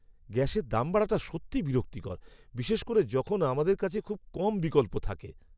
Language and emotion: Bengali, angry